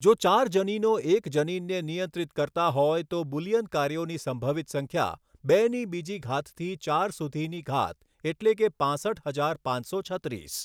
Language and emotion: Gujarati, neutral